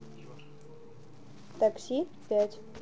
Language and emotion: Russian, neutral